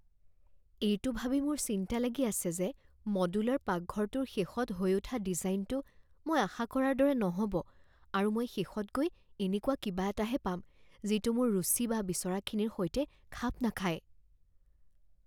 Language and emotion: Assamese, fearful